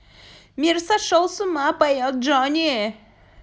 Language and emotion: Russian, positive